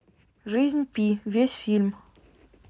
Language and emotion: Russian, neutral